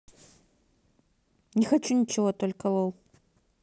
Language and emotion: Russian, angry